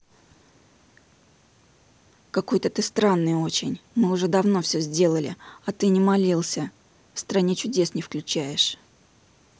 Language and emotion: Russian, angry